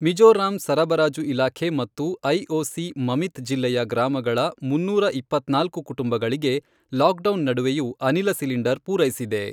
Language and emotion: Kannada, neutral